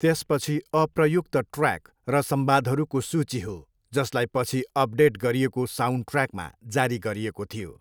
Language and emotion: Nepali, neutral